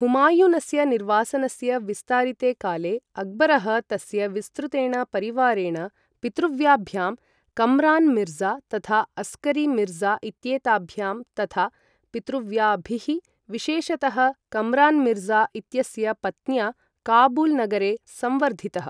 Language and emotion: Sanskrit, neutral